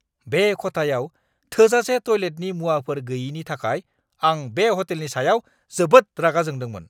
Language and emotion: Bodo, angry